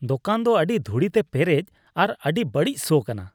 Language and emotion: Santali, disgusted